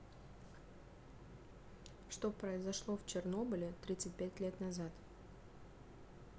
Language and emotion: Russian, neutral